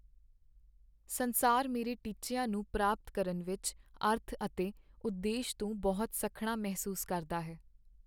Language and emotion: Punjabi, sad